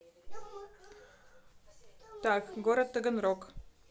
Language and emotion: Russian, neutral